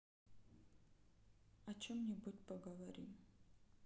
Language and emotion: Russian, sad